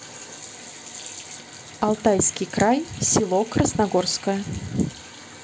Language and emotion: Russian, neutral